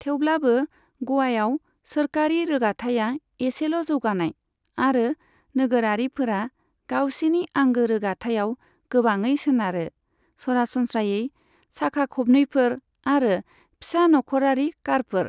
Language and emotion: Bodo, neutral